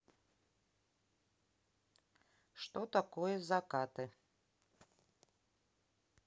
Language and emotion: Russian, neutral